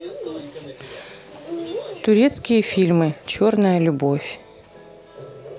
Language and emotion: Russian, neutral